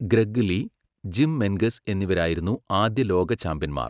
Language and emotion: Malayalam, neutral